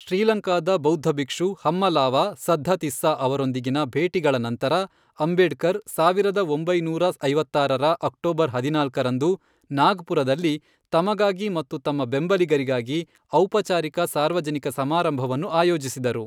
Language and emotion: Kannada, neutral